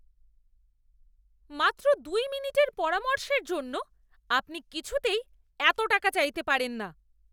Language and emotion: Bengali, angry